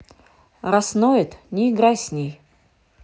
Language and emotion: Russian, angry